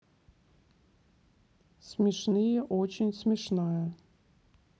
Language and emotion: Russian, neutral